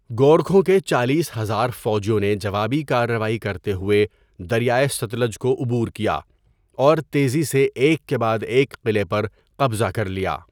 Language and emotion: Urdu, neutral